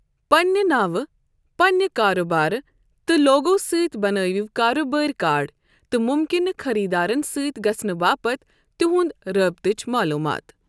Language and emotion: Kashmiri, neutral